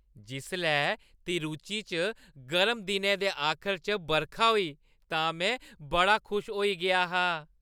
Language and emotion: Dogri, happy